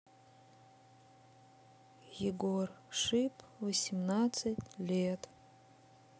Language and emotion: Russian, sad